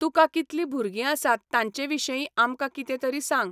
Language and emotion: Goan Konkani, neutral